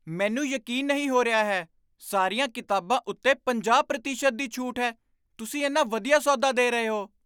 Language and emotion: Punjabi, surprised